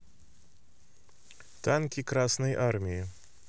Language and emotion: Russian, neutral